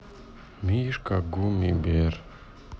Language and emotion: Russian, sad